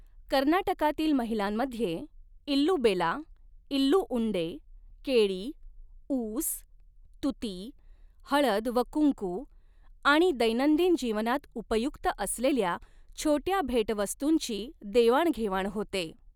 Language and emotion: Marathi, neutral